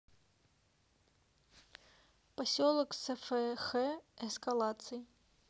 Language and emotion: Russian, neutral